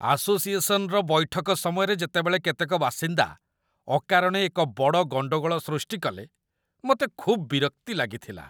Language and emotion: Odia, disgusted